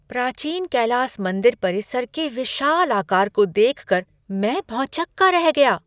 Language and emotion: Hindi, surprised